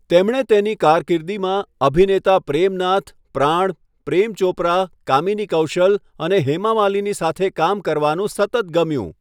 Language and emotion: Gujarati, neutral